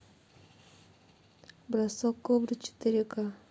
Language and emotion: Russian, neutral